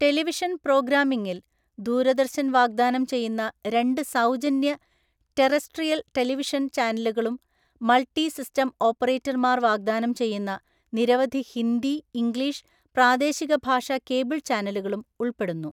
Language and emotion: Malayalam, neutral